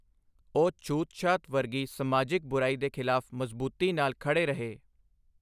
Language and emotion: Punjabi, neutral